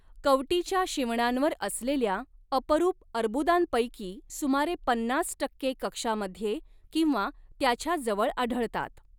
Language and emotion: Marathi, neutral